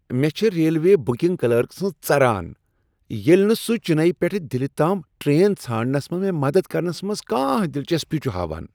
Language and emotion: Kashmiri, disgusted